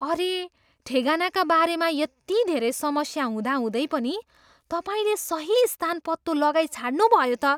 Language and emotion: Nepali, surprised